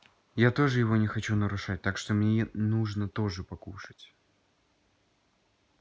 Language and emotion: Russian, neutral